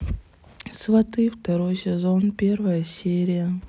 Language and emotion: Russian, sad